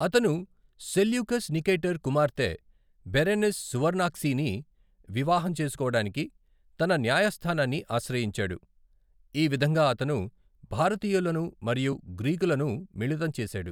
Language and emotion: Telugu, neutral